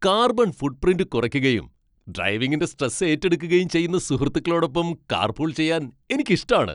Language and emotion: Malayalam, happy